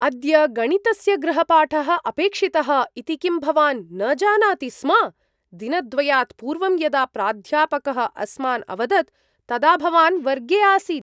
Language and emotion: Sanskrit, surprised